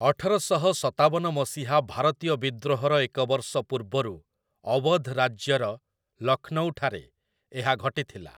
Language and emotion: Odia, neutral